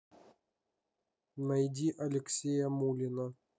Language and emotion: Russian, neutral